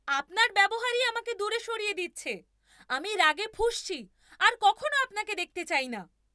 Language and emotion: Bengali, angry